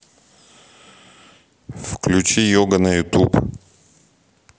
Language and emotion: Russian, neutral